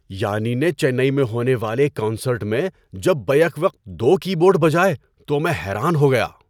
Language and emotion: Urdu, surprised